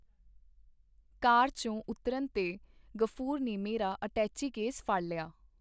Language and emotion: Punjabi, neutral